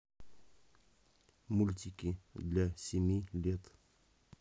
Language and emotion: Russian, neutral